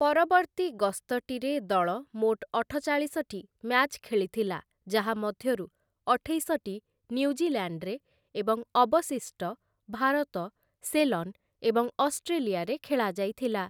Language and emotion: Odia, neutral